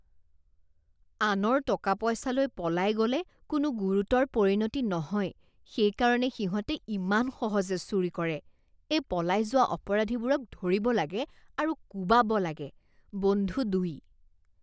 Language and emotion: Assamese, disgusted